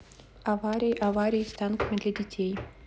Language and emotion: Russian, neutral